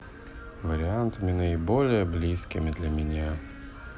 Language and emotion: Russian, sad